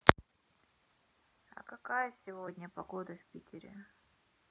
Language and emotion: Russian, neutral